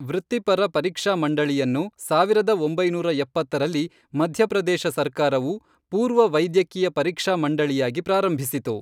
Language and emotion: Kannada, neutral